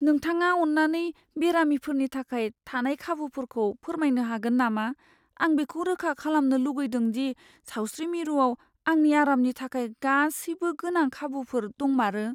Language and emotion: Bodo, fearful